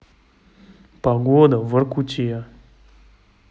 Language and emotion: Russian, neutral